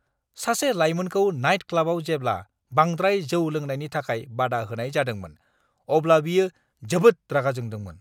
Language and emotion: Bodo, angry